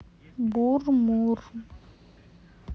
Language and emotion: Russian, neutral